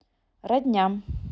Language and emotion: Russian, neutral